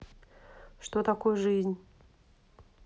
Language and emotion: Russian, neutral